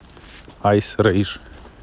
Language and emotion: Russian, neutral